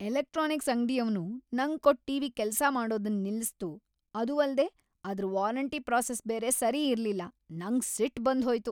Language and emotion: Kannada, angry